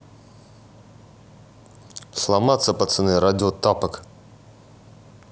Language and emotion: Russian, neutral